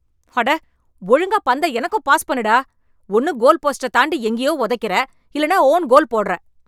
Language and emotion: Tamil, angry